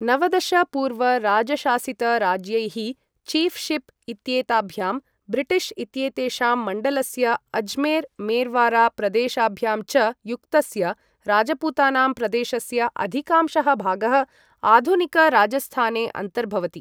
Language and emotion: Sanskrit, neutral